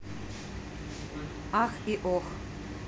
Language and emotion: Russian, neutral